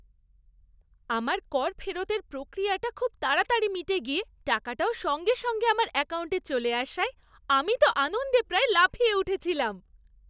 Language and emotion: Bengali, happy